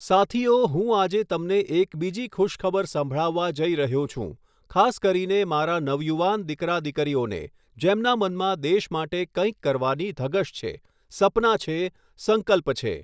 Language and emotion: Gujarati, neutral